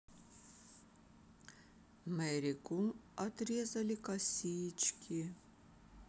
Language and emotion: Russian, neutral